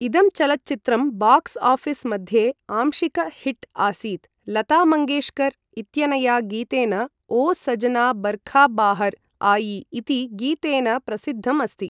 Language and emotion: Sanskrit, neutral